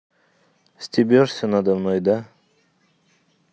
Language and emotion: Russian, neutral